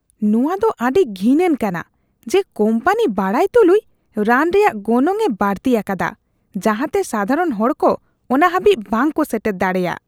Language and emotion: Santali, disgusted